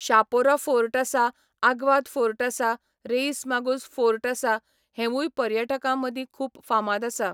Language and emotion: Goan Konkani, neutral